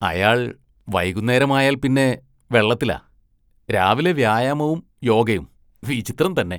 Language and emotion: Malayalam, disgusted